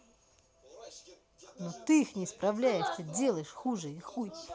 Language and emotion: Russian, angry